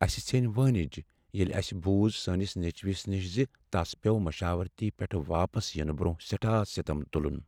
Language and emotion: Kashmiri, sad